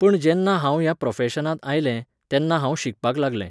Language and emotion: Goan Konkani, neutral